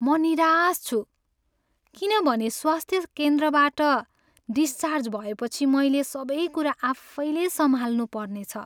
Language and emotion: Nepali, sad